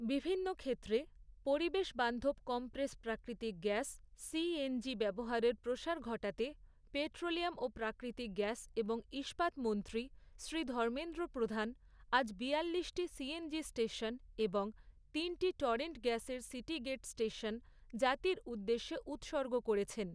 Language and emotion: Bengali, neutral